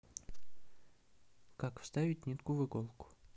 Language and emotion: Russian, neutral